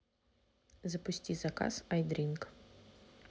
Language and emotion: Russian, neutral